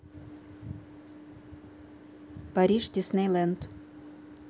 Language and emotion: Russian, neutral